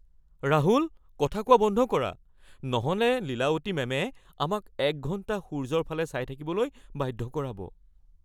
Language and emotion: Assamese, fearful